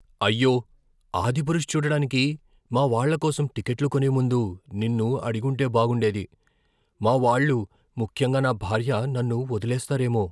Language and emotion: Telugu, fearful